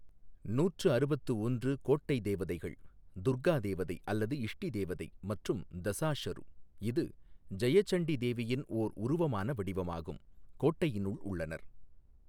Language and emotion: Tamil, neutral